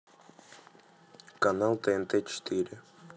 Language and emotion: Russian, neutral